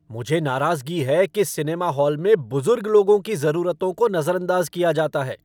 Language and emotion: Hindi, angry